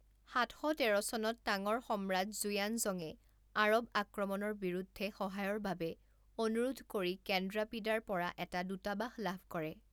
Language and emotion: Assamese, neutral